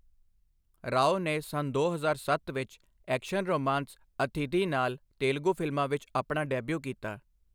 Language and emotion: Punjabi, neutral